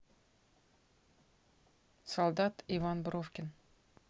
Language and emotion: Russian, neutral